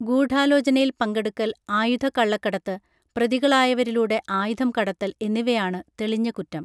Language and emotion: Malayalam, neutral